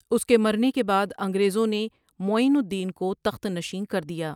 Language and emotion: Urdu, neutral